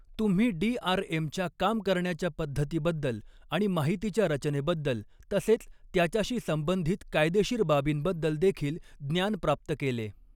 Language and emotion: Marathi, neutral